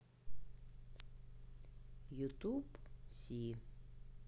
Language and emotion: Russian, neutral